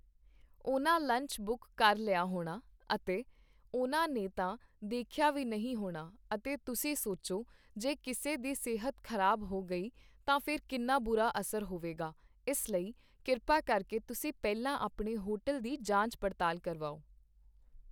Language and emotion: Punjabi, neutral